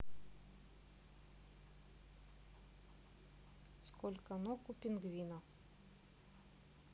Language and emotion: Russian, neutral